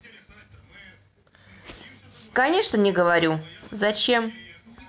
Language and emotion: Russian, neutral